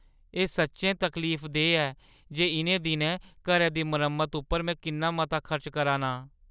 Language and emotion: Dogri, sad